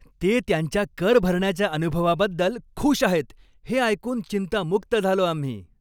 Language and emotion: Marathi, happy